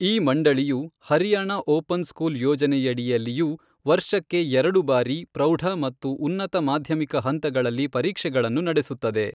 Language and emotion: Kannada, neutral